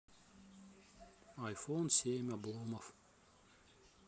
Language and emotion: Russian, neutral